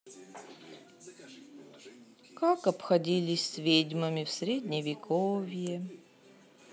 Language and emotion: Russian, sad